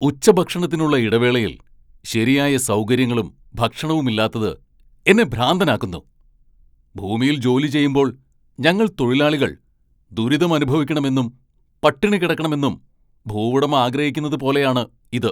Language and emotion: Malayalam, angry